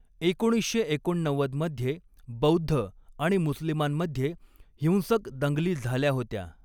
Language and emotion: Marathi, neutral